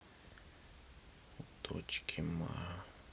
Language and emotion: Russian, sad